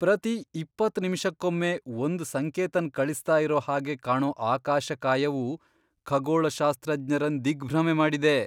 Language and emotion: Kannada, surprised